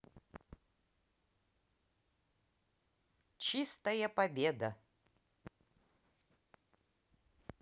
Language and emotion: Russian, positive